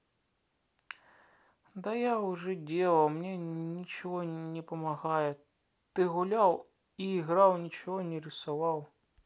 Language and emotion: Russian, sad